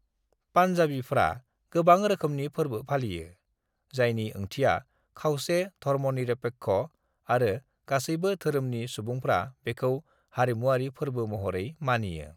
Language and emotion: Bodo, neutral